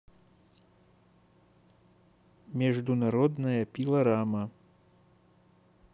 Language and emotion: Russian, neutral